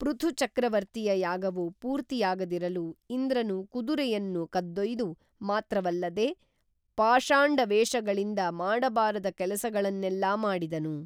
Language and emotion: Kannada, neutral